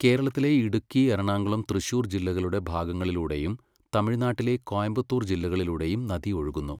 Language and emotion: Malayalam, neutral